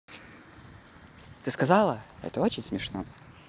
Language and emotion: Russian, neutral